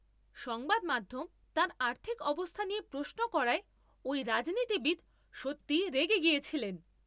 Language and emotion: Bengali, angry